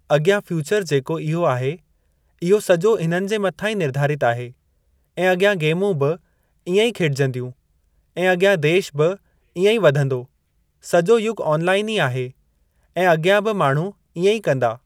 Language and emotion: Sindhi, neutral